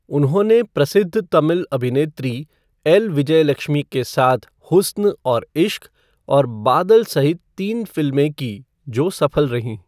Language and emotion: Hindi, neutral